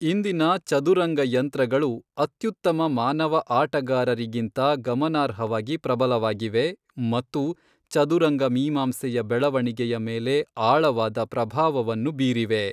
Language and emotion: Kannada, neutral